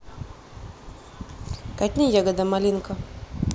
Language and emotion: Russian, neutral